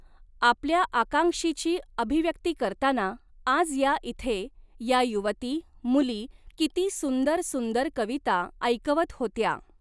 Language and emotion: Marathi, neutral